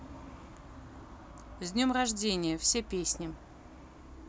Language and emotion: Russian, neutral